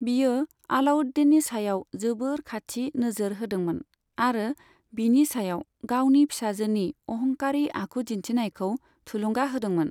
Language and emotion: Bodo, neutral